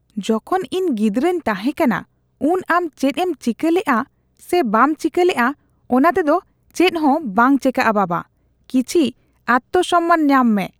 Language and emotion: Santali, disgusted